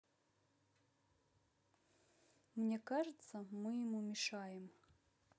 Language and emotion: Russian, neutral